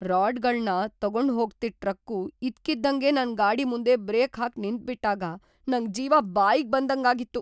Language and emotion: Kannada, fearful